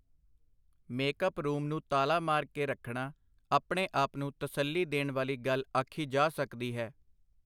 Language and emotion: Punjabi, neutral